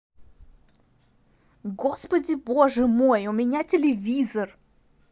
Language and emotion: Russian, angry